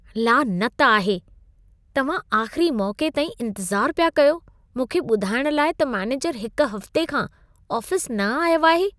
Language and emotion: Sindhi, disgusted